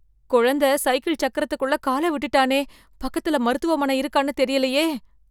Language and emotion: Tamil, fearful